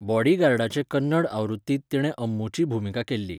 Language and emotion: Goan Konkani, neutral